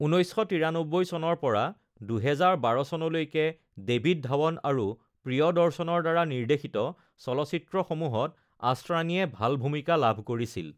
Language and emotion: Assamese, neutral